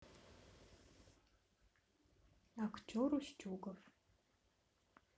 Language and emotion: Russian, neutral